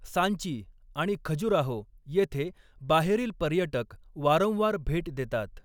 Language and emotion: Marathi, neutral